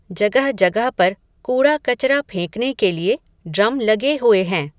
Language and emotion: Hindi, neutral